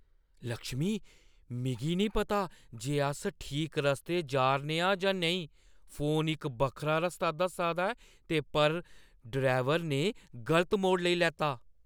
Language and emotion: Dogri, fearful